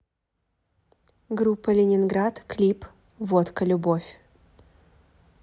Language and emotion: Russian, positive